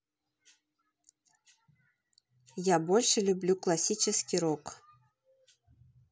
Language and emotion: Russian, neutral